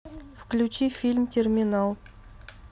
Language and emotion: Russian, neutral